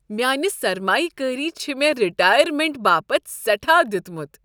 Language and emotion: Kashmiri, happy